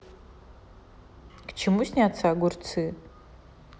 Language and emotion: Russian, neutral